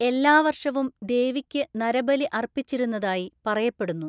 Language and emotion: Malayalam, neutral